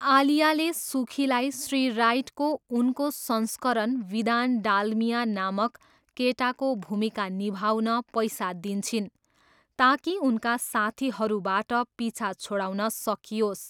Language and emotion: Nepali, neutral